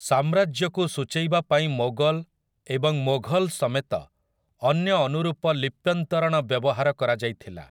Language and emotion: Odia, neutral